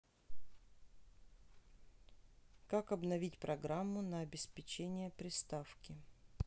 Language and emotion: Russian, neutral